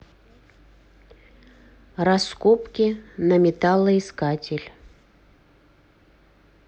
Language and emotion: Russian, neutral